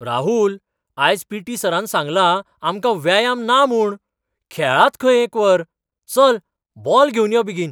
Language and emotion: Goan Konkani, surprised